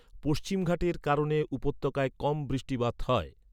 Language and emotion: Bengali, neutral